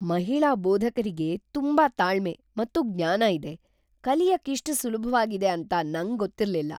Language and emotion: Kannada, surprised